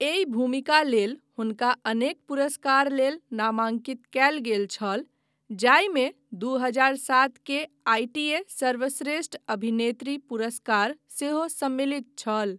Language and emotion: Maithili, neutral